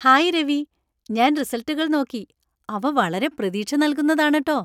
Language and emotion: Malayalam, happy